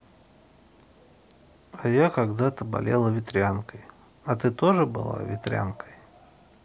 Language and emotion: Russian, sad